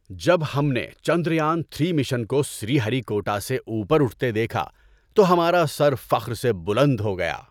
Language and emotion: Urdu, happy